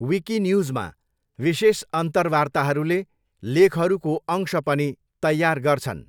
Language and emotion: Nepali, neutral